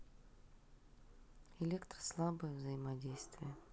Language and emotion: Russian, neutral